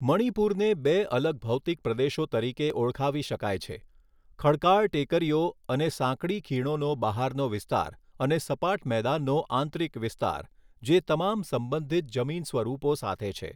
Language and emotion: Gujarati, neutral